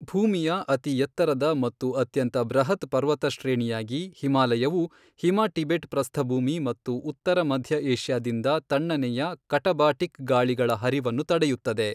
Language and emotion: Kannada, neutral